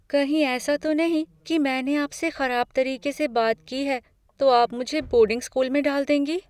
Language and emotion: Hindi, fearful